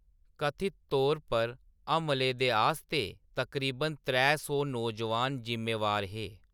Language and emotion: Dogri, neutral